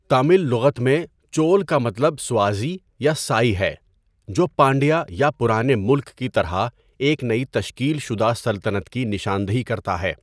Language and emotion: Urdu, neutral